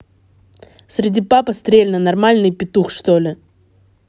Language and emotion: Russian, angry